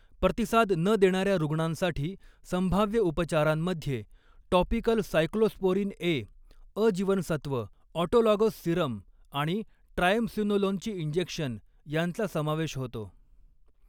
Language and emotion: Marathi, neutral